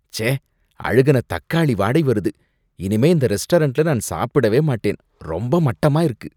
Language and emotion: Tamil, disgusted